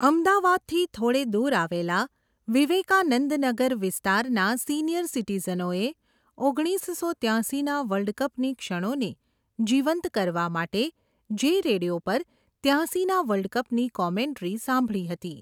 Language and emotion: Gujarati, neutral